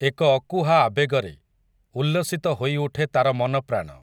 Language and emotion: Odia, neutral